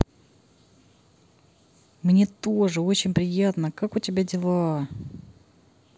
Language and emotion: Russian, positive